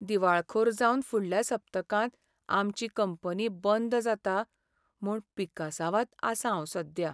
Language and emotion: Goan Konkani, sad